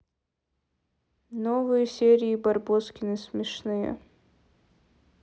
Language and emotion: Russian, neutral